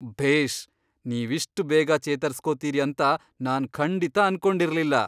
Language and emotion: Kannada, surprised